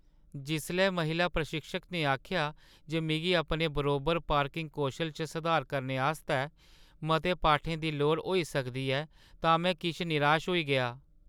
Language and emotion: Dogri, sad